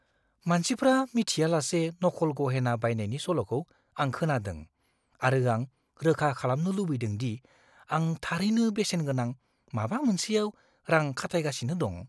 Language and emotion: Bodo, fearful